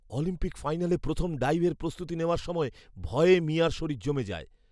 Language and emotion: Bengali, fearful